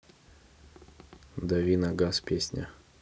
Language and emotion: Russian, neutral